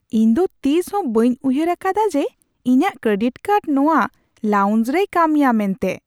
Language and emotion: Santali, surprised